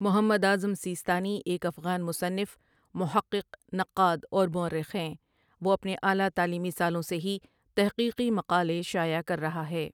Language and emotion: Urdu, neutral